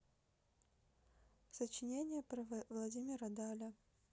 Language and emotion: Russian, neutral